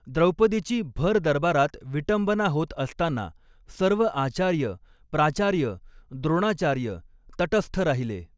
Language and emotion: Marathi, neutral